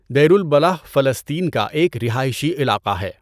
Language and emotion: Urdu, neutral